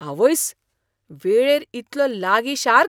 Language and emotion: Goan Konkani, surprised